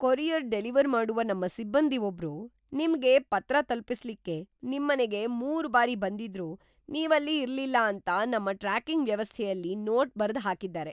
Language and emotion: Kannada, surprised